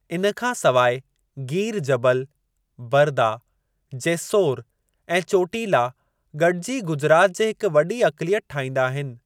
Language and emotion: Sindhi, neutral